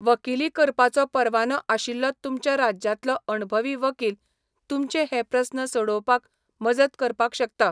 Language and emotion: Goan Konkani, neutral